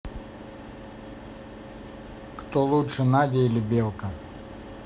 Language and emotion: Russian, neutral